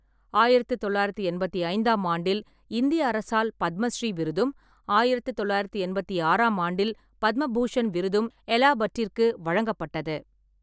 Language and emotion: Tamil, neutral